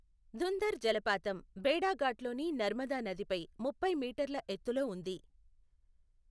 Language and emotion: Telugu, neutral